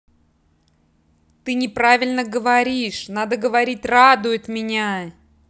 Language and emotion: Russian, angry